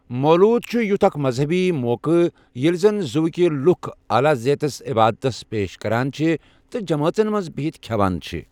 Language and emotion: Kashmiri, neutral